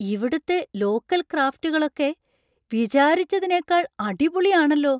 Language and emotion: Malayalam, surprised